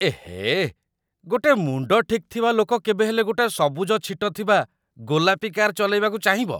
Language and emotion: Odia, disgusted